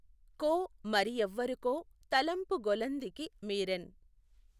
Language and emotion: Telugu, neutral